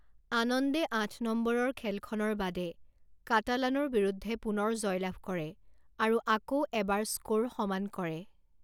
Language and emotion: Assamese, neutral